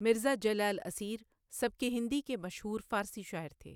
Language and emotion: Urdu, neutral